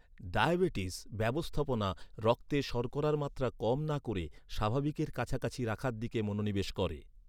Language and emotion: Bengali, neutral